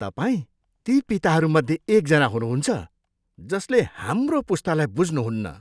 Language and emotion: Nepali, disgusted